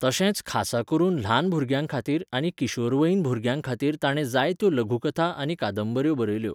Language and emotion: Goan Konkani, neutral